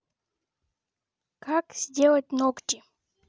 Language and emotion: Russian, neutral